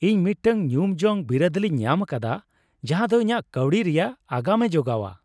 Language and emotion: Santali, happy